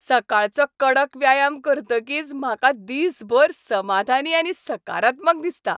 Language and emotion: Goan Konkani, happy